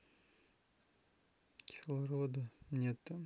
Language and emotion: Russian, sad